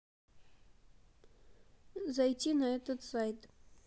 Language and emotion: Russian, neutral